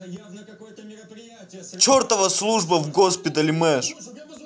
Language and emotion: Russian, angry